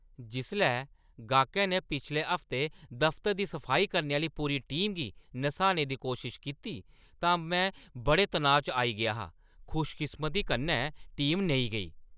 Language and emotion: Dogri, angry